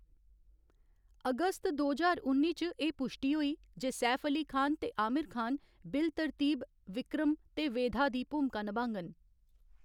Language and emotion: Dogri, neutral